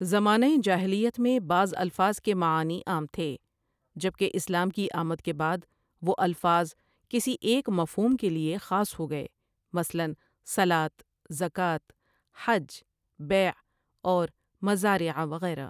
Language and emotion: Urdu, neutral